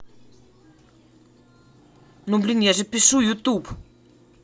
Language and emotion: Russian, angry